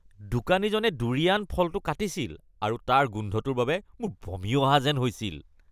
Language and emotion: Assamese, disgusted